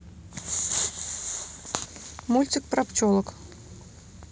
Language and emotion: Russian, neutral